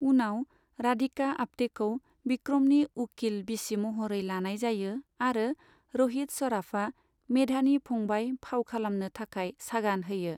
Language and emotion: Bodo, neutral